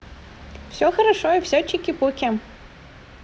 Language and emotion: Russian, positive